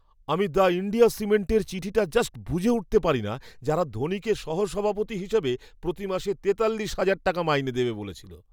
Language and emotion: Bengali, surprised